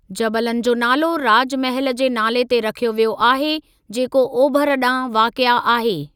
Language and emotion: Sindhi, neutral